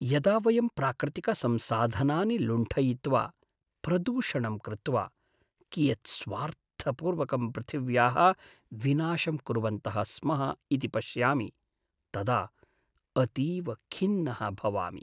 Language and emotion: Sanskrit, sad